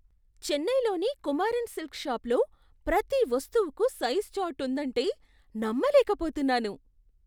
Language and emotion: Telugu, surprised